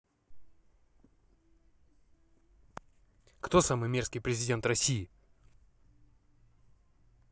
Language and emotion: Russian, angry